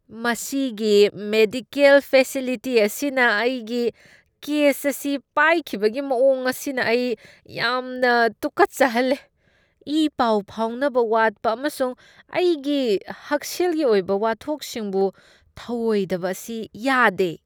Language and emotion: Manipuri, disgusted